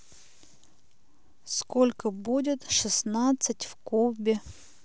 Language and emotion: Russian, neutral